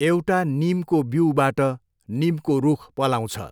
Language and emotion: Nepali, neutral